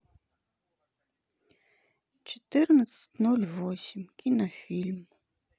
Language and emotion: Russian, sad